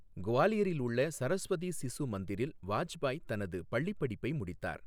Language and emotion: Tamil, neutral